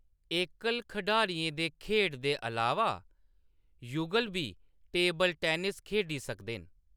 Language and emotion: Dogri, neutral